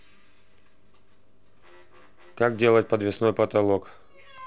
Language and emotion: Russian, neutral